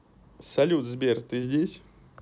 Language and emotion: Russian, neutral